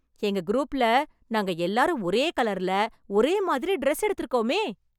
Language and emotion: Tamil, happy